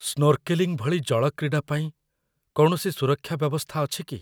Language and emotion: Odia, fearful